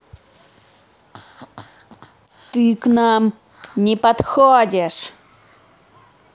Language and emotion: Russian, angry